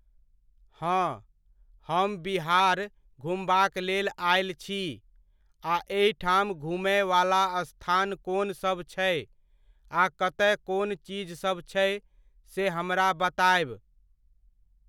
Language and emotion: Maithili, neutral